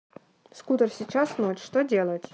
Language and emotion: Russian, neutral